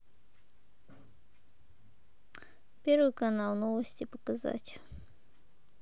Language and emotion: Russian, neutral